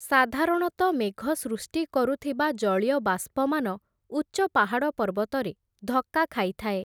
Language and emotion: Odia, neutral